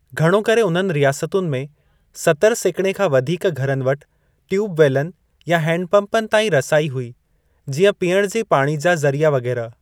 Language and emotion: Sindhi, neutral